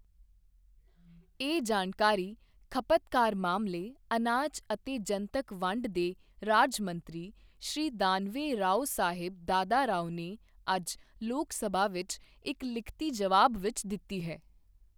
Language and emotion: Punjabi, neutral